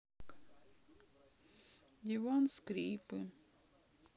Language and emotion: Russian, sad